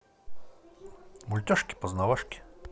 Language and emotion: Russian, positive